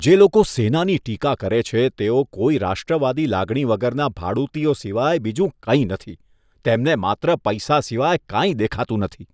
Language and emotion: Gujarati, disgusted